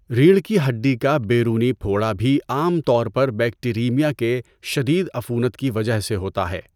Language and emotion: Urdu, neutral